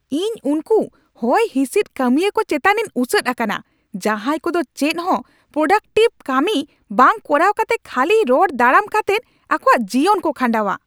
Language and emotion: Santali, angry